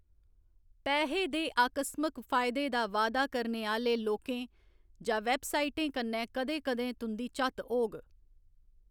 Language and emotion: Dogri, neutral